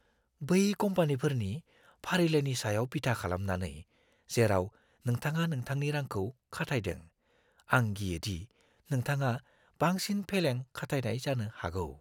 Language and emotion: Bodo, fearful